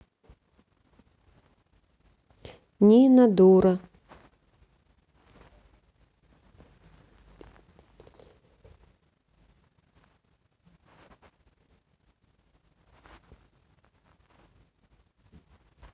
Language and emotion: Russian, neutral